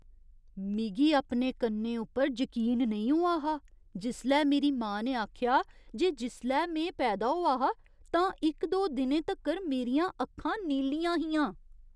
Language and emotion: Dogri, surprised